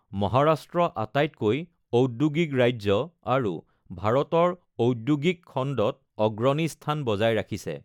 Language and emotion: Assamese, neutral